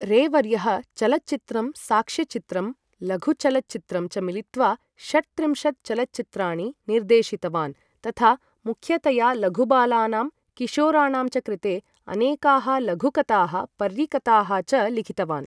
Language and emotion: Sanskrit, neutral